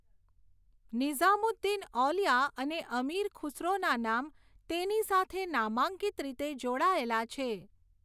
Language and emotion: Gujarati, neutral